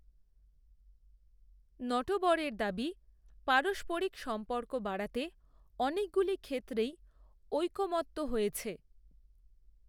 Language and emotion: Bengali, neutral